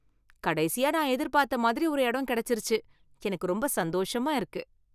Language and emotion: Tamil, happy